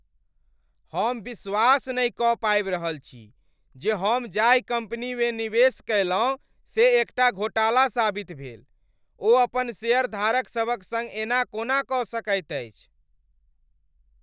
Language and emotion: Maithili, angry